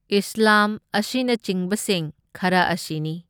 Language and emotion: Manipuri, neutral